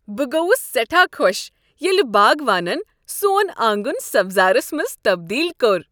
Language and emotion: Kashmiri, happy